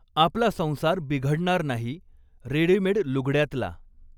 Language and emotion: Marathi, neutral